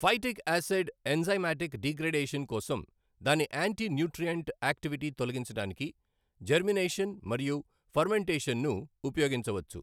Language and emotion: Telugu, neutral